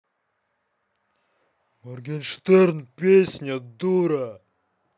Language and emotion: Russian, angry